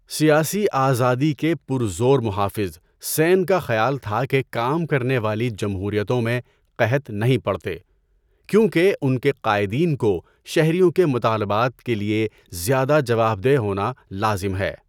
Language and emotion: Urdu, neutral